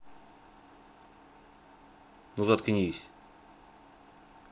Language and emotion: Russian, angry